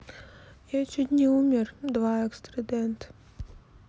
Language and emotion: Russian, sad